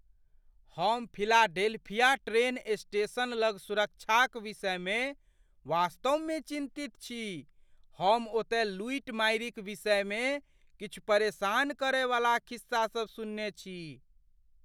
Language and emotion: Maithili, fearful